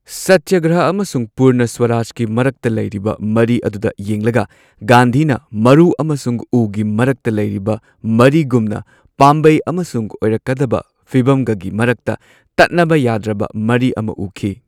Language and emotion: Manipuri, neutral